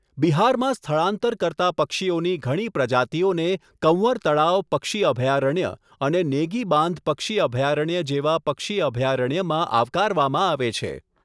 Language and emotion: Gujarati, neutral